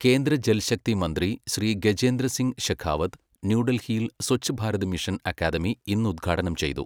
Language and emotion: Malayalam, neutral